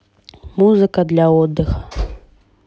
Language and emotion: Russian, neutral